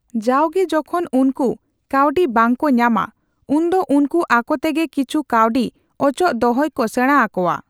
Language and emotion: Santali, neutral